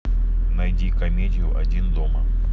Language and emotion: Russian, neutral